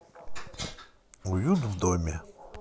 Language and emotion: Russian, neutral